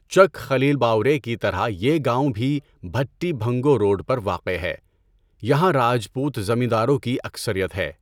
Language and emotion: Urdu, neutral